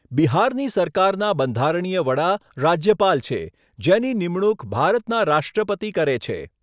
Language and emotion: Gujarati, neutral